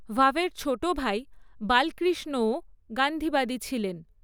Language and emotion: Bengali, neutral